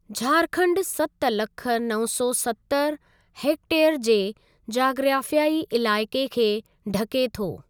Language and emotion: Sindhi, neutral